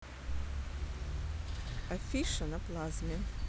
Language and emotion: Russian, neutral